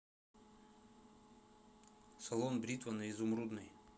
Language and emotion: Russian, neutral